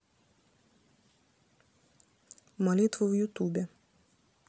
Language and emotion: Russian, neutral